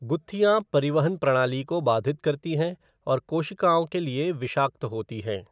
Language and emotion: Hindi, neutral